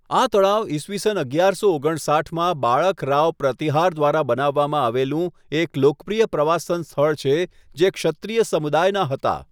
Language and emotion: Gujarati, neutral